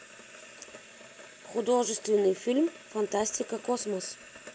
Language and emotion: Russian, neutral